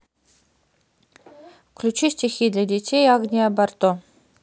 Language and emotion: Russian, neutral